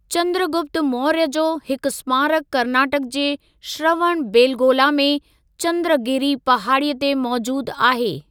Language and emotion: Sindhi, neutral